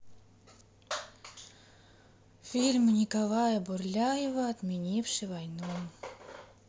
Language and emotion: Russian, sad